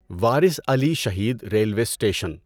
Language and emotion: Urdu, neutral